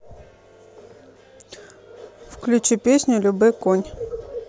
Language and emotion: Russian, neutral